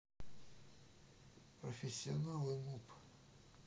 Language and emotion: Russian, neutral